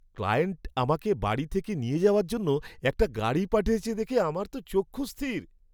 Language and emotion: Bengali, surprised